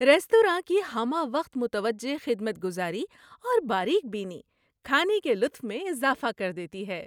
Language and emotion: Urdu, happy